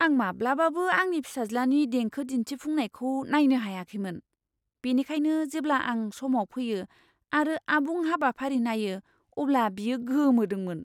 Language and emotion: Bodo, surprised